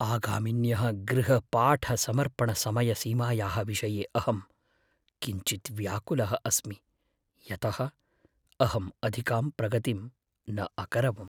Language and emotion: Sanskrit, fearful